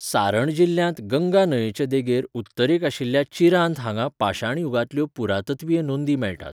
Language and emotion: Goan Konkani, neutral